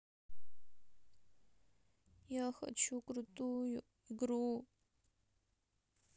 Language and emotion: Russian, sad